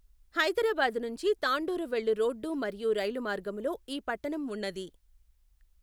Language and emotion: Telugu, neutral